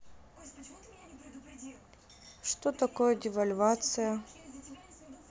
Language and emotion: Russian, neutral